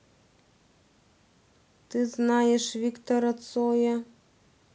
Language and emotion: Russian, neutral